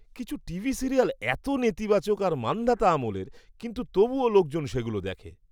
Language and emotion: Bengali, disgusted